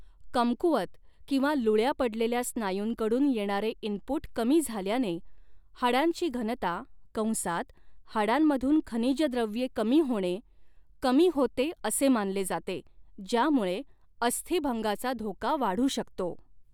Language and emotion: Marathi, neutral